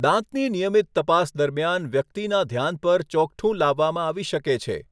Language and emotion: Gujarati, neutral